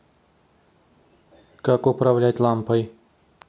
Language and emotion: Russian, neutral